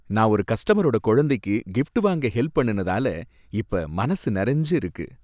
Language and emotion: Tamil, happy